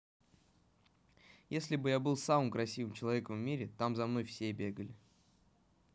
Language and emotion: Russian, neutral